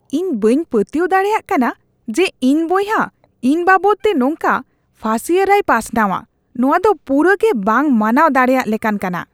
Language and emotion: Santali, disgusted